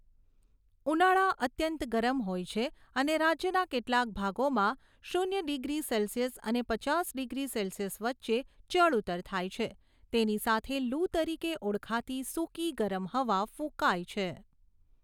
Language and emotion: Gujarati, neutral